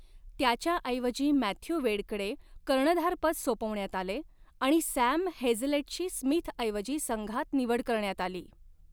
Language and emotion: Marathi, neutral